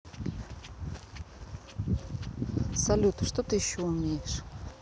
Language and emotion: Russian, neutral